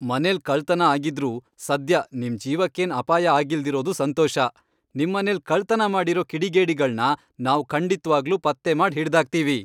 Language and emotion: Kannada, happy